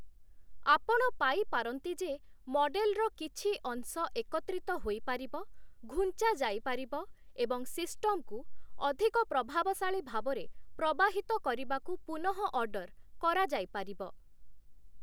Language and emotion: Odia, neutral